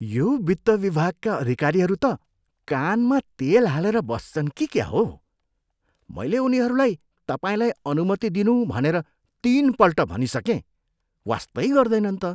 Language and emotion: Nepali, disgusted